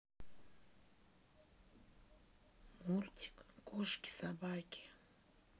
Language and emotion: Russian, sad